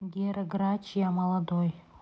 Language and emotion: Russian, neutral